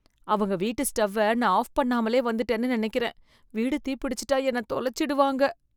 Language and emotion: Tamil, fearful